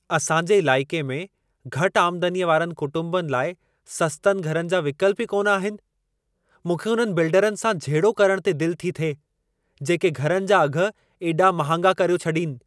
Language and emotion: Sindhi, angry